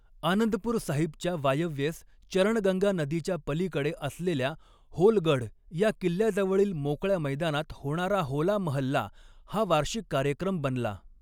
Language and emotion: Marathi, neutral